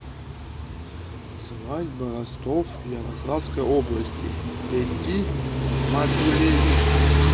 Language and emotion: Russian, neutral